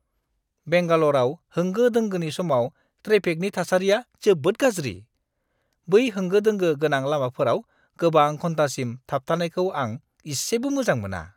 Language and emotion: Bodo, disgusted